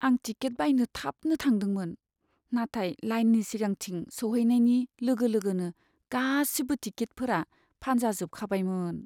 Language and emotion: Bodo, sad